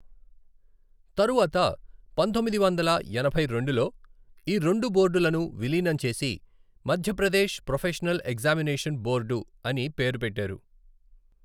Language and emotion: Telugu, neutral